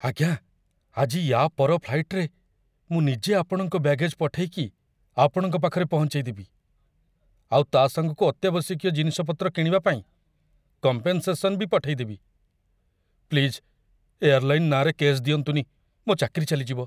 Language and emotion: Odia, fearful